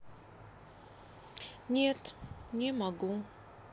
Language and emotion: Russian, sad